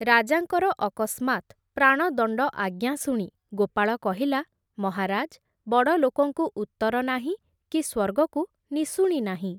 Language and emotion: Odia, neutral